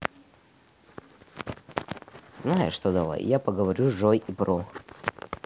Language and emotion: Russian, neutral